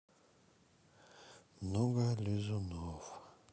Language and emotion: Russian, sad